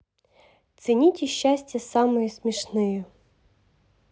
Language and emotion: Russian, positive